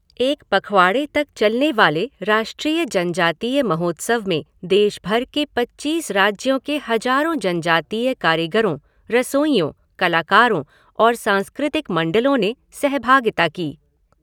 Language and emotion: Hindi, neutral